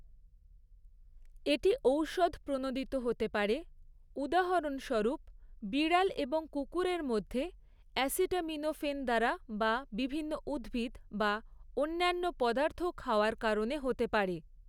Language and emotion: Bengali, neutral